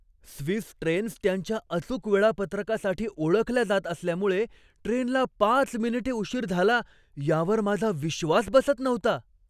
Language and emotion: Marathi, surprised